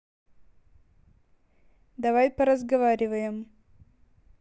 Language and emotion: Russian, neutral